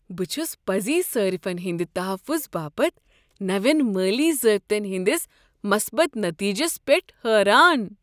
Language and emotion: Kashmiri, surprised